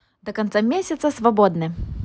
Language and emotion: Russian, positive